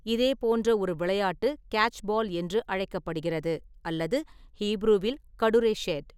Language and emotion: Tamil, neutral